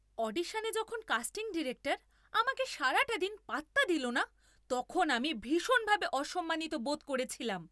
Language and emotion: Bengali, angry